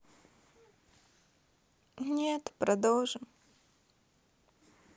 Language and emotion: Russian, sad